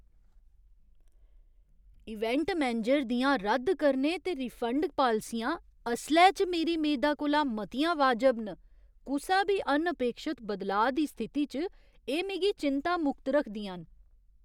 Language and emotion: Dogri, surprised